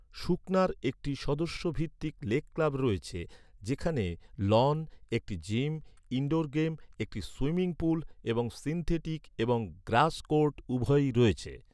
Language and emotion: Bengali, neutral